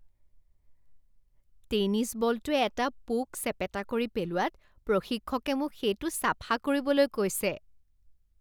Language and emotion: Assamese, disgusted